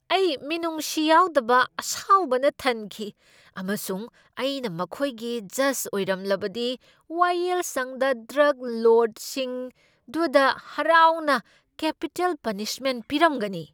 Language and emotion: Manipuri, angry